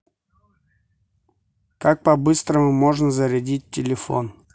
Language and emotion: Russian, neutral